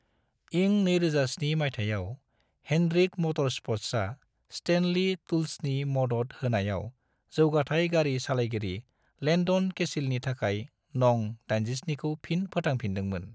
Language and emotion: Bodo, neutral